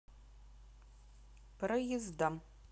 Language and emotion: Russian, neutral